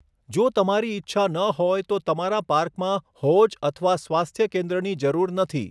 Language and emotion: Gujarati, neutral